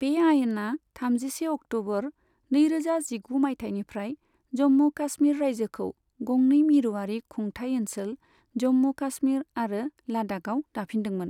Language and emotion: Bodo, neutral